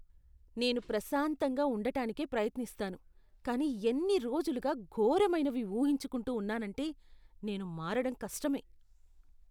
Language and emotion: Telugu, disgusted